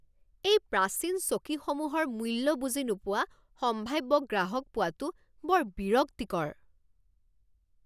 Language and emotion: Assamese, angry